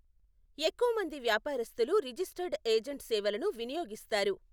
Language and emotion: Telugu, neutral